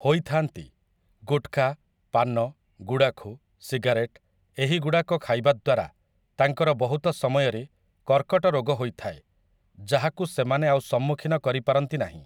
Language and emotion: Odia, neutral